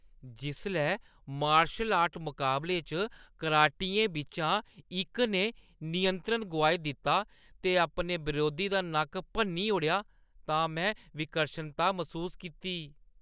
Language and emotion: Dogri, disgusted